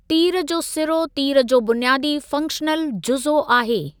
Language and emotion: Sindhi, neutral